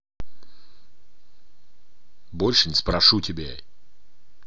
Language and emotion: Russian, angry